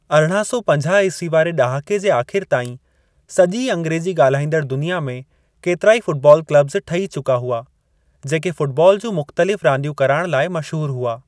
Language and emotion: Sindhi, neutral